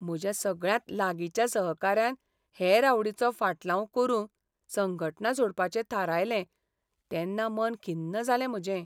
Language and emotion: Goan Konkani, sad